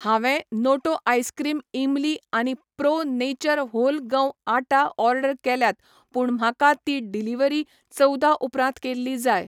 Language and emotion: Goan Konkani, neutral